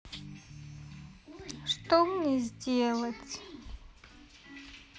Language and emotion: Russian, sad